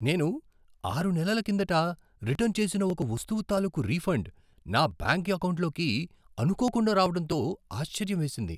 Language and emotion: Telugu, surprised